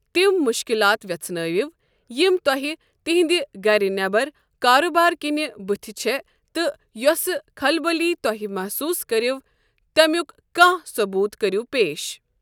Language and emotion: Kashmiri, neutral